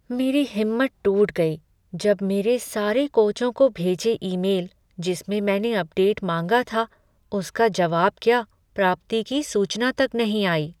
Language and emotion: Hindi, sad